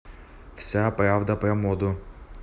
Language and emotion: Russian, neutral